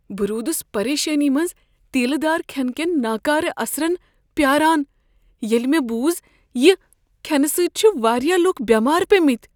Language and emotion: Kashmiri, fearful